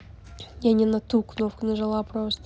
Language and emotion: Russian, neutral